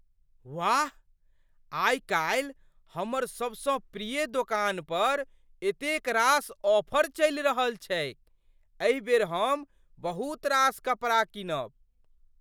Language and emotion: Maithili, surprised